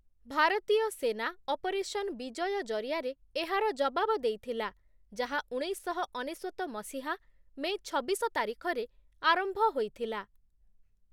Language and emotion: Odia, neutral